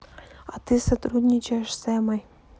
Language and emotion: Russian, neutral